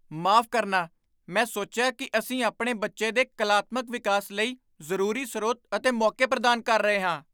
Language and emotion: Punjabi, surprised